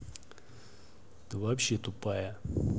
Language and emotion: Russian, angry